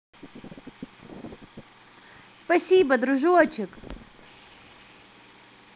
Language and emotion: Russian, positive